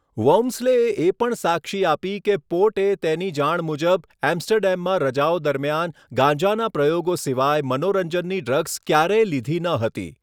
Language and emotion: Gujarati, neutral